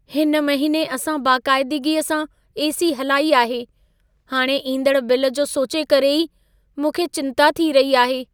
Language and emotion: Sindhi, fearful